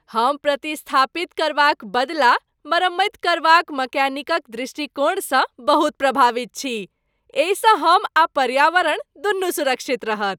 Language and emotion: Maithili, happy